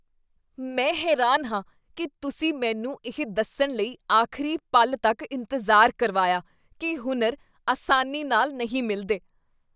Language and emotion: Punjabi, disgusted